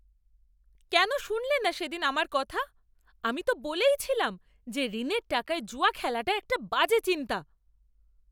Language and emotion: Bengali, angry